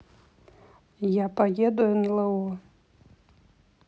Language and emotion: Russian, neutral